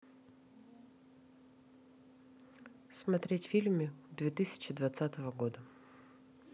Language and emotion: Russian, neutral